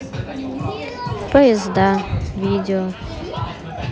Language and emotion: Russian, sad